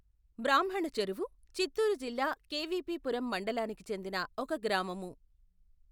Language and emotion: Telugu, neutral